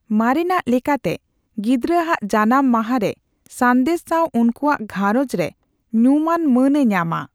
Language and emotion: Santali, neutral